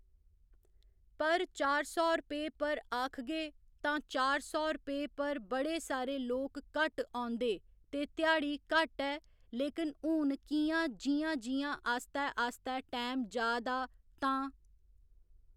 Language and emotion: Dogri, neutral